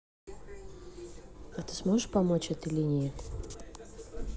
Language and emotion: Russian, neutral